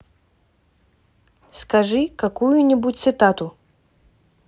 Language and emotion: Russian, neutral